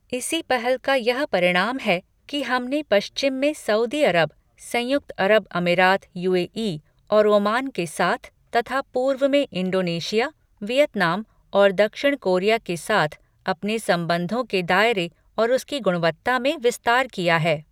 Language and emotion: Hindi, neutral